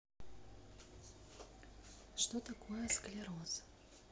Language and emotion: Russian, neutral